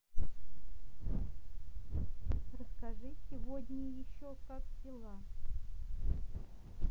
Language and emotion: Russian, neutral